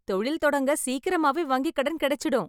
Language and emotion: Tamil, happy